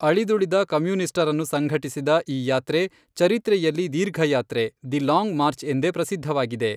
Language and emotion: Kannada, neutral